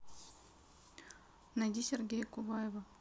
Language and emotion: Russian, neutral